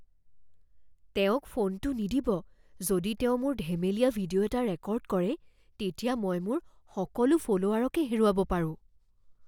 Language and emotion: Assamese, fearful